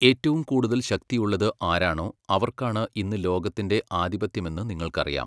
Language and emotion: Malayalam, neutral